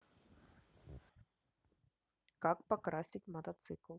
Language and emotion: Russian, neutral